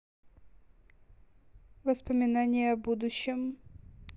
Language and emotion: Russian, neutral